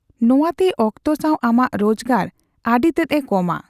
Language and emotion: Santali, neutral